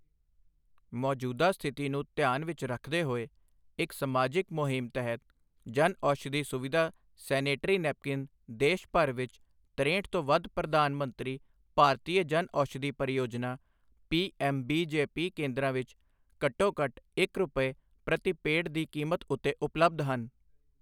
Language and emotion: Punjabi, neutral